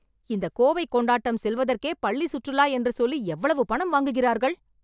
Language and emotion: Tamil, angry